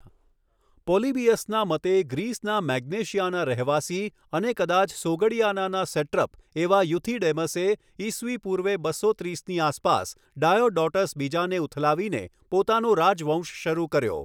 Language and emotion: Gujarati, neutral